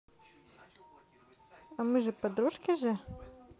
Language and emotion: Russian, positive